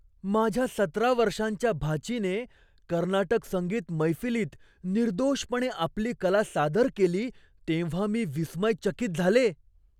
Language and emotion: Marathi, surprised